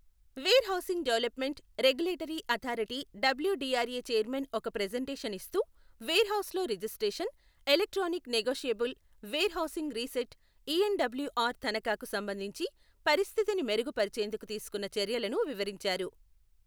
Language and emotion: Telugu, neutral